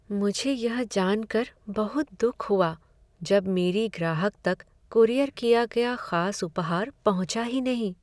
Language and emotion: Hindi, sad